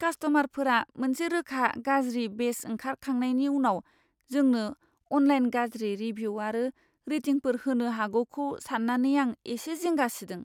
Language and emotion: Bodo, fearful